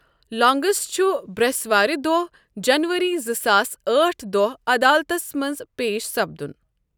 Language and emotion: Kashmiri, neutral